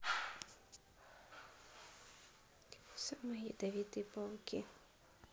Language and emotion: Russian, neutral